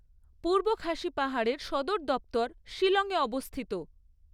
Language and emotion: Bengali, neutral